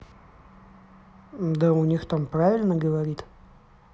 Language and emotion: Russian, neutral